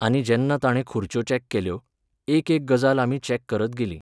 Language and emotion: Goan Konkani, neutral